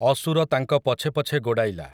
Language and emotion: Odia, neutral